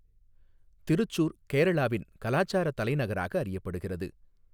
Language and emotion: Tamil, neutral